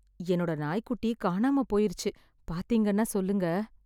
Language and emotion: Tamil, sad